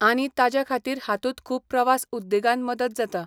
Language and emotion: Goan Konkani, neutral